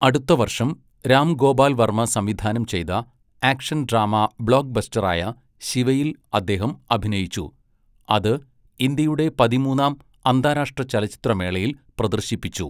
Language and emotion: Malayalam, neutral